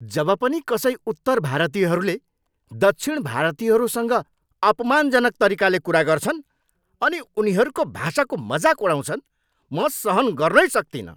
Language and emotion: Nepali, angry